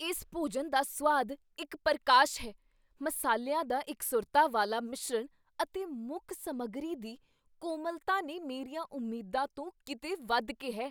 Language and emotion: Punjabi, surprised